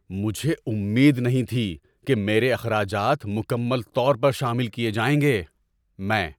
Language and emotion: Urdu, surprised